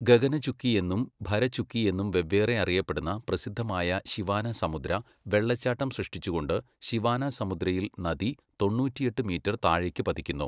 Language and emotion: Malayalam, neutral